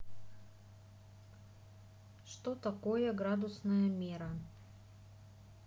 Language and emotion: Russian, neutral